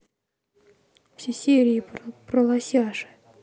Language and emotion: Russian, neutral